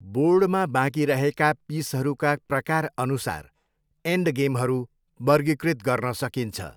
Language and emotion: Nepali, neutral